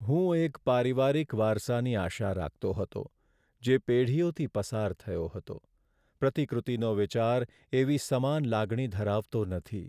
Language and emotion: Gujarati, sad